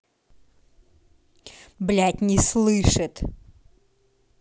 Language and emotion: Russian, angry